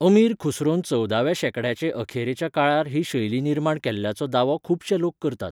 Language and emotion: Goan Konkani, neutral